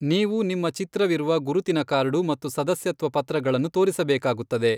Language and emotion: Kannada, neutral